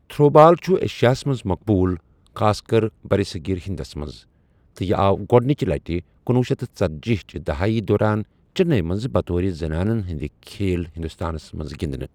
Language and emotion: Kashmiri, neutral